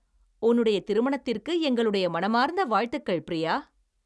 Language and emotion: Tamil, happy